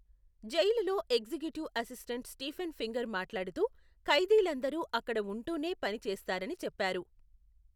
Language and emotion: Telugu, neutral